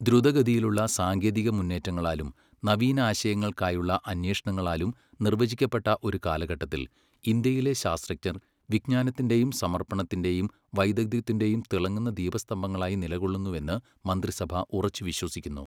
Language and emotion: Malayalam, neutral